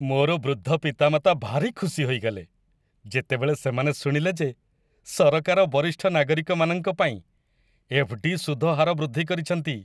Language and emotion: Odia, happy